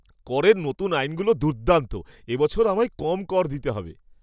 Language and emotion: Bengali, surprised